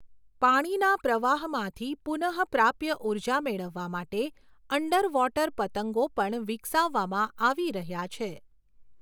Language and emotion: Gujarati, neutral